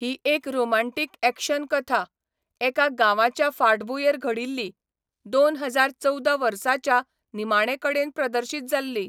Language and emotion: Goan Konkani, neutral